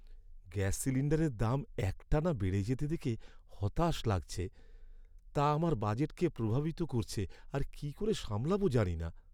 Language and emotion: Bengali, sad